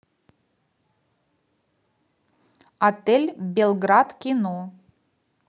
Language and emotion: Russian, neutral